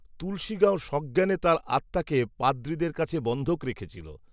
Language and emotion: Bengali, neutral